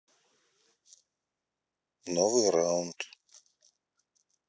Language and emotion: Russian, neutral